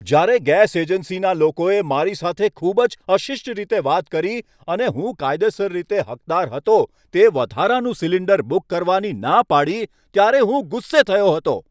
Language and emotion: Gujarati, angry